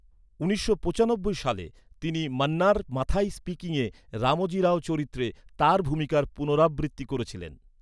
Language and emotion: Bengali, neutral